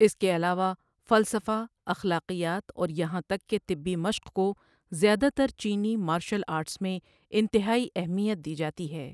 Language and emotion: Urdu, neutral